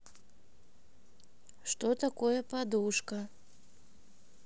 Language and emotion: Russian, neutral